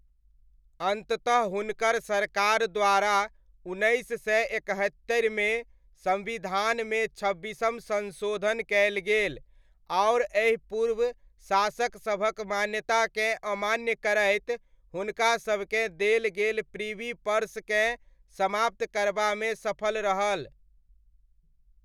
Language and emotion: Maithili, neutral